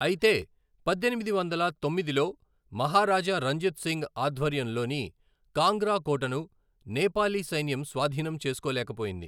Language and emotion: Telugu, neutral